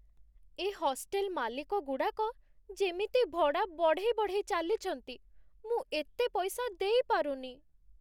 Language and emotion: Odia, sad